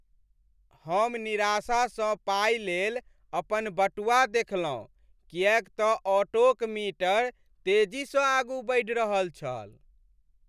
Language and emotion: Maithili, sad